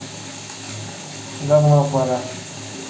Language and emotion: Russian, neutral